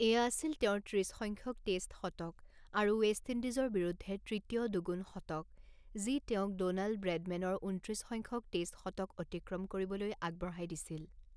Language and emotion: Assamese, neutral